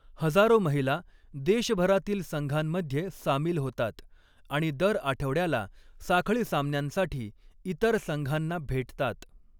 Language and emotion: Marathi, neutral